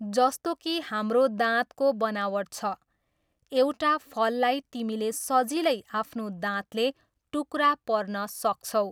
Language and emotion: Nepali, neutral